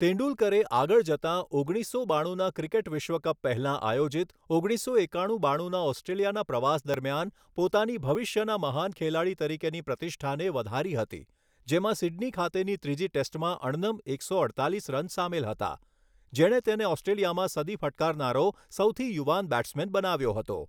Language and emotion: Gujarati, neutral